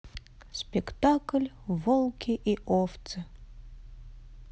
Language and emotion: Russian, sad